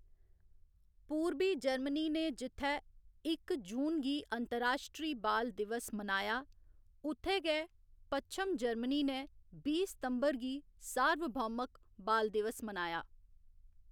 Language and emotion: Dogri, neutral